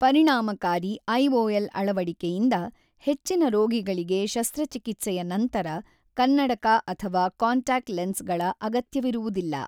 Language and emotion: Kannada, neutral